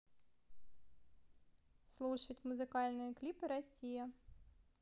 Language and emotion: Russian, neutral